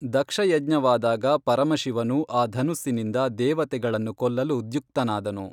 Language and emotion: Kannada, neutral